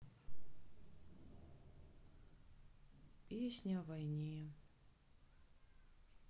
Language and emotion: Russian, sad